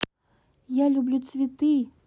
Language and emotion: Russian, sad